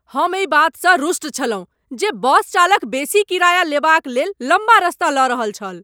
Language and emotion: Maithili, angry